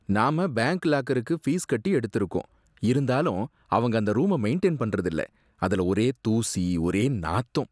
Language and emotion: Tamil, disgusted